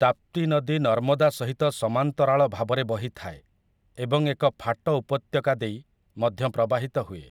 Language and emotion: Odia, neutral